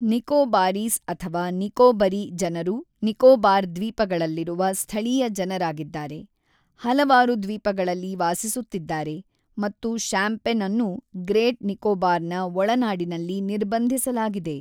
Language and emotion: Kannada, neutral